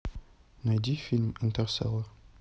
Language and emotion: Russian, neutral